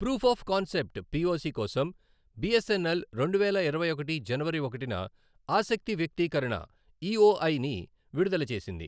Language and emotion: Telugu, neutral